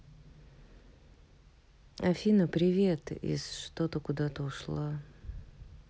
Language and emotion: Russian, sad